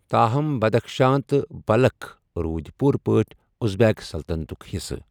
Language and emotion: Kashmiri, neutral